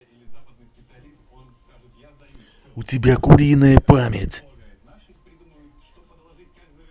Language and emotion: Russian, angry